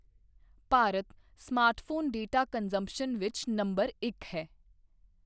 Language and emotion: Punjabi, neutral